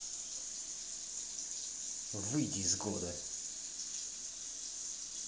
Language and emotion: Russian, angry